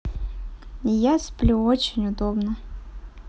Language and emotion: Russian, neutral